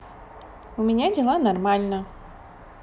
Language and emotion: Russian, positive